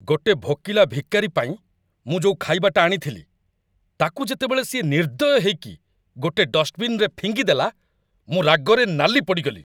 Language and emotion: Odia, angry